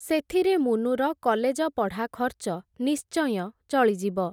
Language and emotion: Odia, neutral